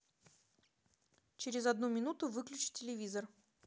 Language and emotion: Russian, neutral